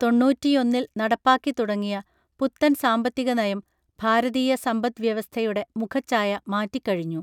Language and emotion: Malayalam, neutral